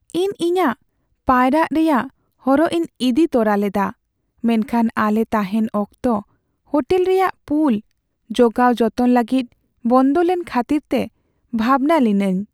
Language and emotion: Santali, sad